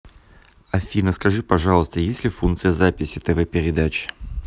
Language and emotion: Russian, neutral